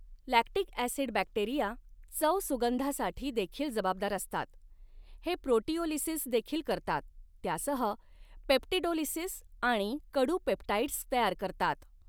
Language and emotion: Marathi, neutral